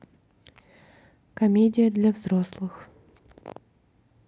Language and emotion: Russian, neutral